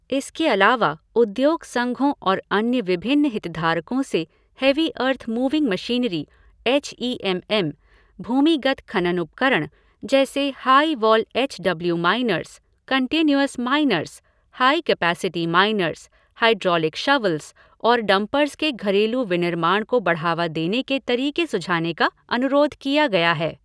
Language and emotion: Hindi, neutral